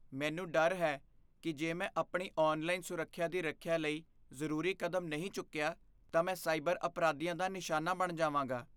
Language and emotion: Punjabi, fearful